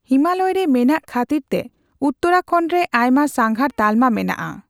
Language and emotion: Santali, neutral